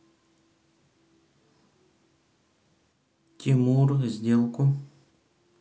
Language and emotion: Russian, neutral